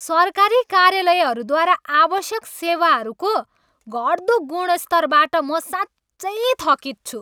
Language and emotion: Nepali, angry